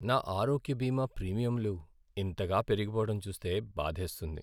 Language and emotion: Telugu, sad